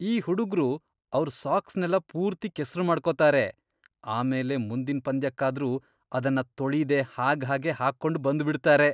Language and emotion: Kannada, disgusted